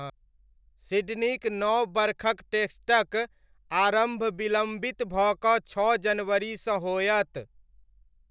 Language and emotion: Maithili, neutral